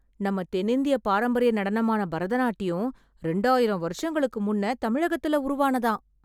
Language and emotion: Tamil, surprised